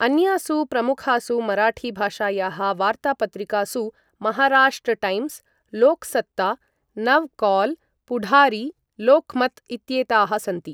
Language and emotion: Sanskrit, neutral